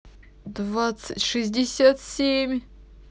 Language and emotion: Russian, sad